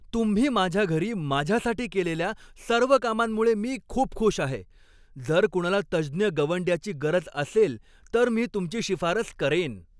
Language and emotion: Marathi, happy